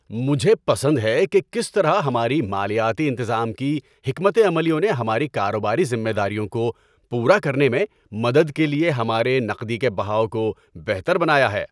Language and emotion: Urdu, happy